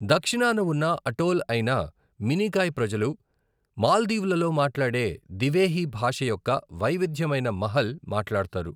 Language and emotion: Telugu, neutral